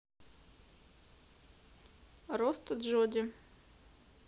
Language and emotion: Russian, neutral